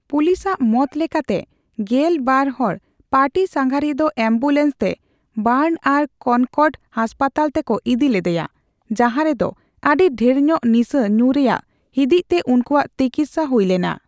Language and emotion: Santali, neutral